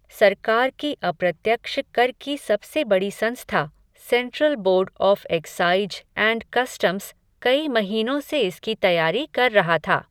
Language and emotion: Hindi, neutral